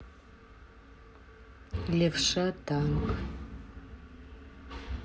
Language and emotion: Russian, neutral